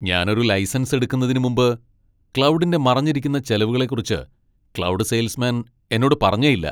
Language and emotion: Malayalam, angry